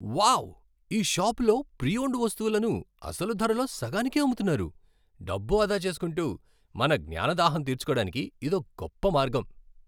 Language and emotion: Telugu, happy